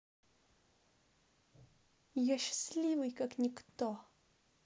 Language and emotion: Russian, positive